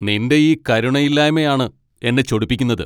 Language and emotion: Malayalam, angry